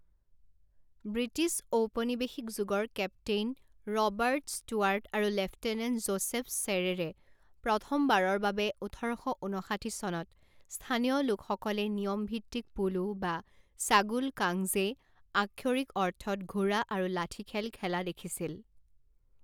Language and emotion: Assamese, neutral